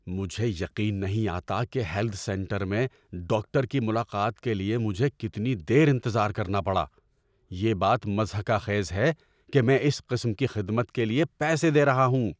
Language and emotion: Urdu, angry